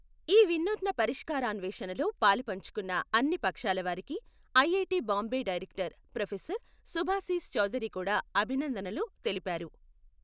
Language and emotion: Telugu, neutral